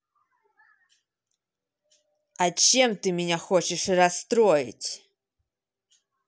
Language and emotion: Russian, angry